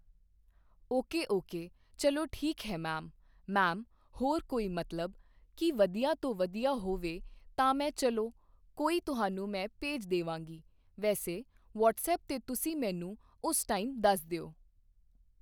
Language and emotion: Punjabi, neutral